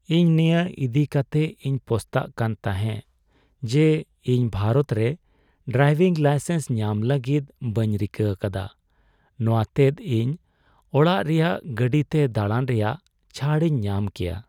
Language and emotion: Santali, sad